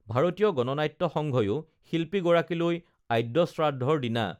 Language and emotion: Assamese, neutral